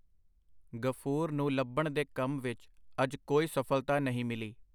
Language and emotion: Punjabi, neutral